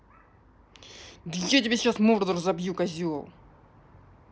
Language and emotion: Russian, angry